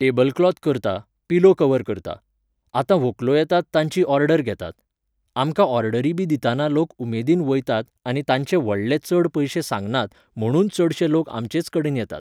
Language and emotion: Goan Konkani, neutral